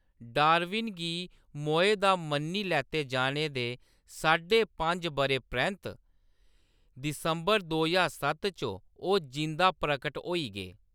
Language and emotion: Dogri, neutral